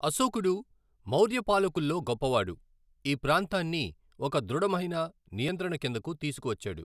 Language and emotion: Telugu, neutral